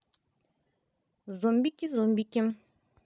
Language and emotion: Russian, positive